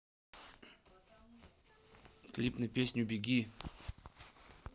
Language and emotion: Russian, neutral